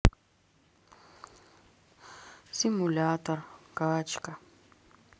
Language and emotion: Russian, sad